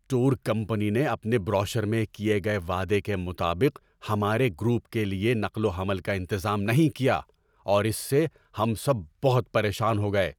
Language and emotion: Urdu, angry